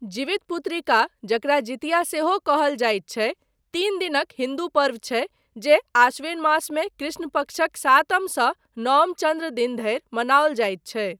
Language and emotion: Maithili, neutral